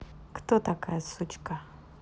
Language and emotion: Russian, positive